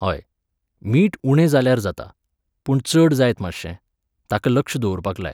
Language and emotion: Goan Konkani, neutral